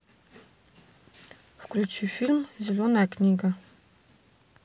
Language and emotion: Russian, neutral